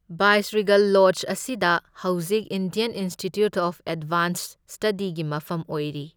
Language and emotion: Manipuri, neutral